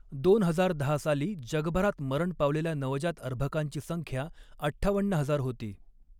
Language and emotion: Marathi, neutral